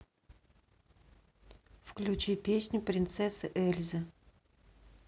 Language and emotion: Russian, neutral